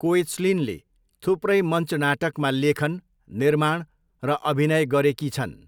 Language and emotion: Nepali, neutral